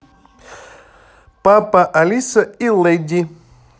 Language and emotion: Russian, positive